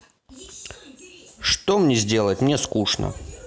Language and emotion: Russian, neutral